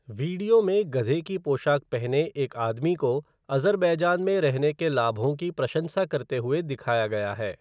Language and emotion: Hindi, neutral